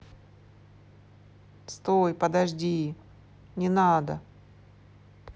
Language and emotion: Russian, neutral